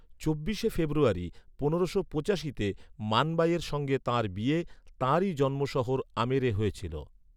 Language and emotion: Bengali, neutral